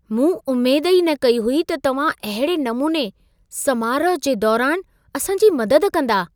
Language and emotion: Sindhi, surprised